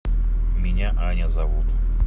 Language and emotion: Russian, neutral